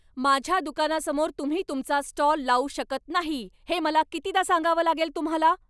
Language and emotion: Marathi, angry